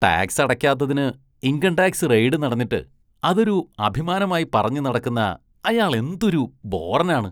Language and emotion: Malayalam, disgusted